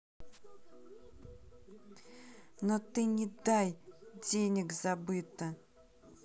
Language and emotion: Russian, angry